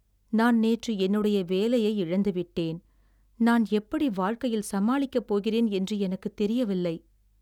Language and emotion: Tamil, sad